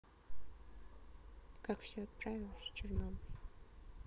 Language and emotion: Russian, sad